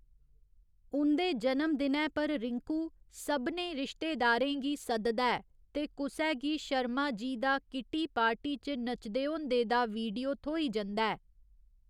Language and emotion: Dogri, neutral